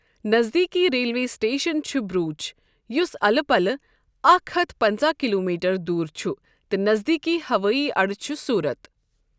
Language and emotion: Kashmiri, neutral